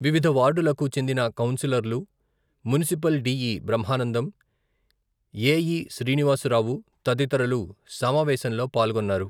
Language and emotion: Telugu, neutral